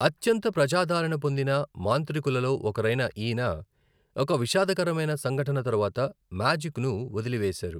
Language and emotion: Telugu, neutral